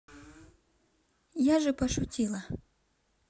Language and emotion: Russian, neutral